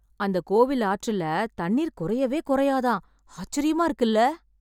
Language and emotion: Tamil, surprised